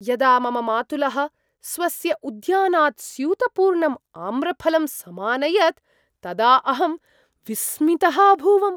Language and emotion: Sanskrit, surprised